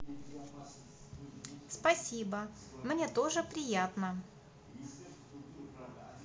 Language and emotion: Russian, positive